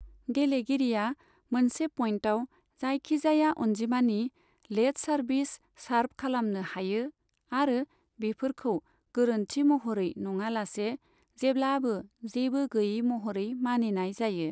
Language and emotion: Bodo, neutral